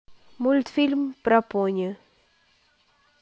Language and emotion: Russian, neutral